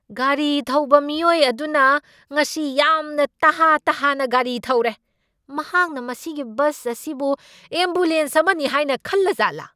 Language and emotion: Manipuri, angry